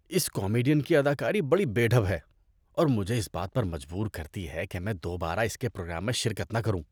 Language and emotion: Urdu, disgusted